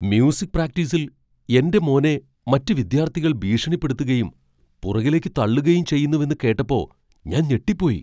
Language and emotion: Malayalam, surprised